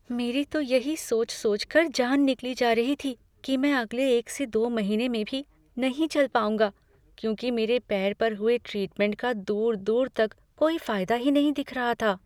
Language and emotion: Hindi, fearful